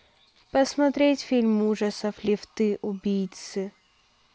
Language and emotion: Russian, neutral